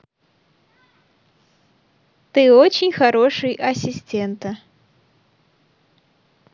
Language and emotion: Russian, positive